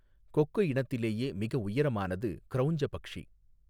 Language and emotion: Tamil, neutral